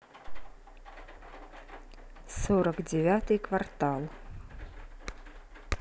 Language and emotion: Russian, neutral